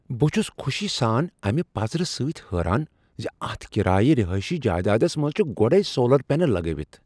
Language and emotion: Kashmiri, surprised